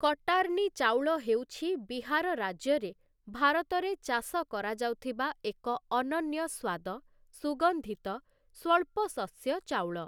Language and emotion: Odia, neutral